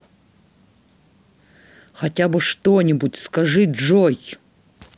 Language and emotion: Russian, angry